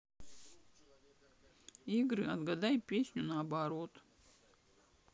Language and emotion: Russian, sad